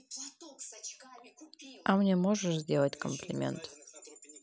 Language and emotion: Russian, neutral